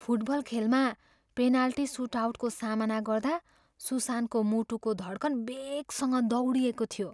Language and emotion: Nepali, fearful